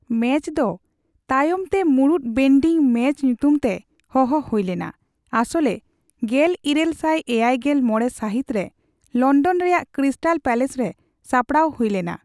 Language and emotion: Santali, neutral